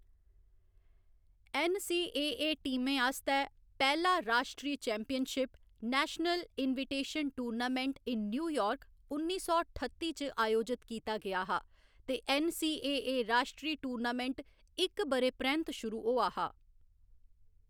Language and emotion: Dogri, neutral